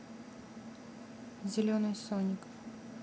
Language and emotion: Russian, neutral